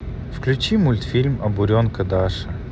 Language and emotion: Russian, neutral